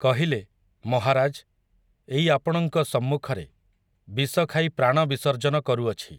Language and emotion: Odia, neutral